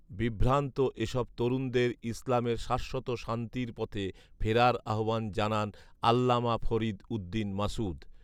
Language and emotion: Bengali, neutral